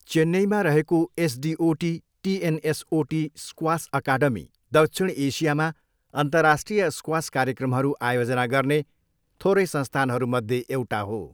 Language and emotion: Nepali, neutral